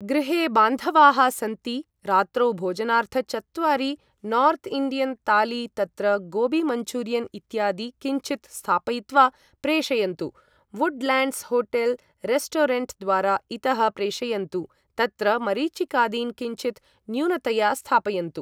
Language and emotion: Sanskrit, neutral